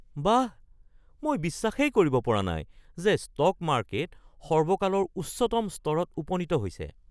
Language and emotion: Assamese, surprised